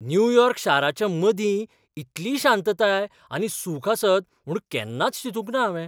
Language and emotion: Goan Konkani, surprised